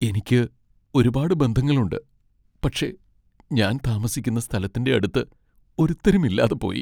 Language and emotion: Malayalam, sad